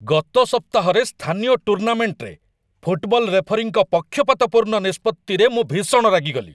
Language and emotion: Odia, angry